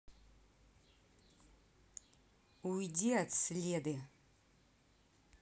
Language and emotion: Russian, angry